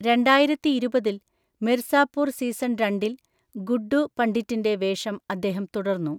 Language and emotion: Malayalam, neutral